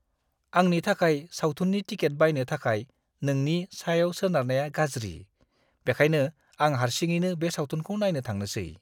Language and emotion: Bodo, disgusted